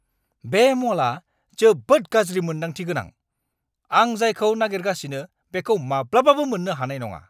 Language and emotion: Bodo, angry